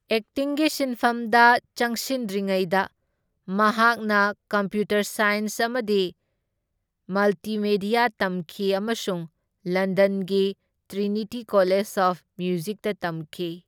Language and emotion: Manipuri, neutral